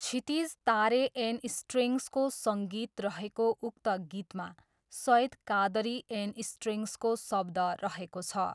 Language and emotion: Nepali, neutral